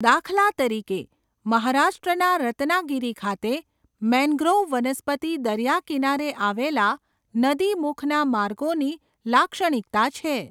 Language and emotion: Gujarati, neutral